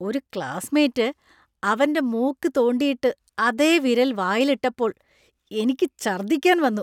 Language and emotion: Malayalam, disgusted